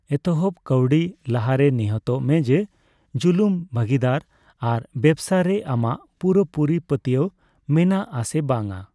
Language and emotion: Santali, neutral